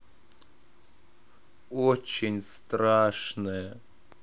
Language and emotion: Russian, sad